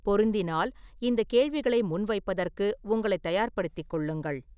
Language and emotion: Tamil, neutral